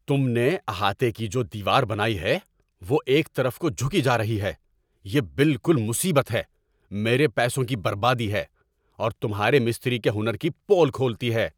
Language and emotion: Urdu, angry